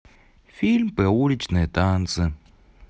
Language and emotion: Russian, neutral